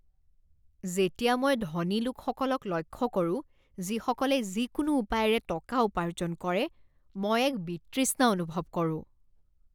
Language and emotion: Assamese, disgusted